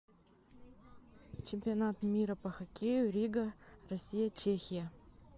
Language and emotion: Russian, neutral